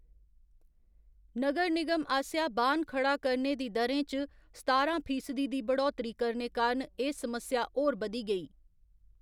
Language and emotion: Dogri, neutral